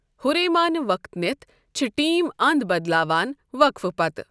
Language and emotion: Kashmiri, neutral